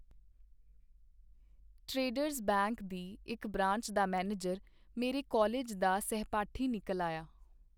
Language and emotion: Punjabi, neutral